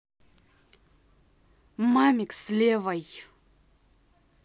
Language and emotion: Russian, angry